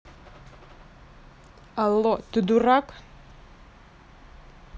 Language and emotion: Russian, angry